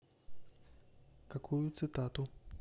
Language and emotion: Russian, neutral